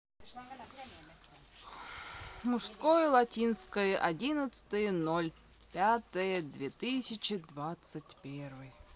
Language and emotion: Russian, neutral